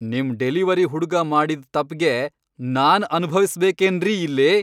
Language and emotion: Kannada, angry